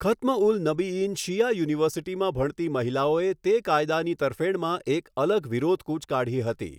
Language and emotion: Gujarati, neutral